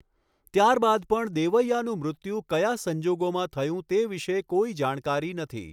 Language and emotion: Gujarati, neutral